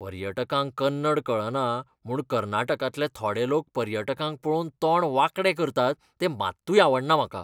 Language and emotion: Goan Konkani, disgusted